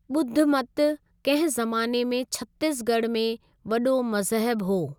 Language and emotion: Sindhi, neutral